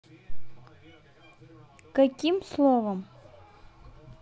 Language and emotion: Russian, neutral